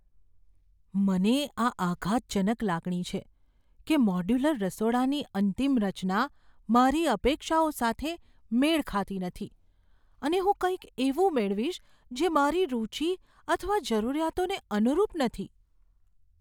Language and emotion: Gujarati, fearful